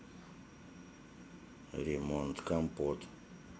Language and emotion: Russian, neutral